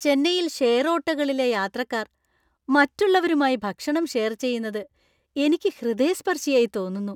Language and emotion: Malayalam, happy